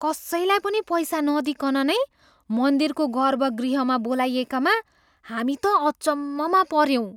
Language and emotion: Nepali, surprised